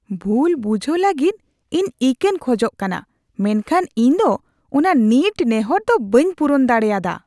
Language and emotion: Santali, disgusted